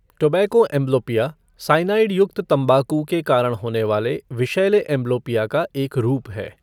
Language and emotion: Hindi, neutral